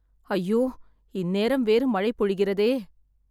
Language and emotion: Tamil, sad